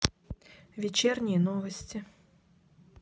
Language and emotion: Russian, neutral